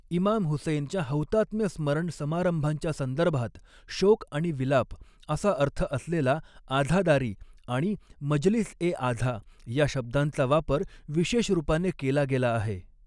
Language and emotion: Marathi, neutral